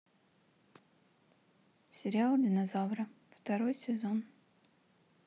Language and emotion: Russian, neutral